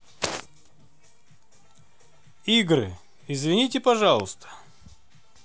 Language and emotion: Russian, neutral